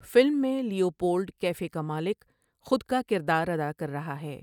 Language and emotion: Urdu, neutral